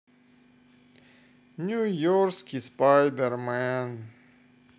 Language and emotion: Russian, sad